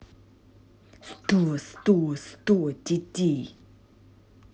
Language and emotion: Russian, angry